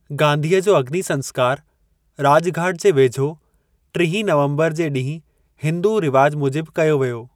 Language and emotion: Sindhi, neutral